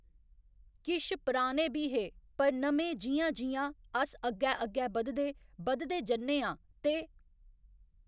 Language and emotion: Dogri, neutral